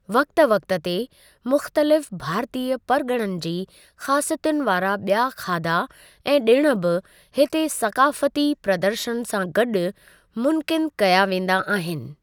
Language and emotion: Sindhi, neutral